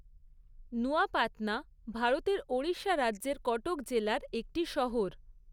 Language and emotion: Bengali, neutral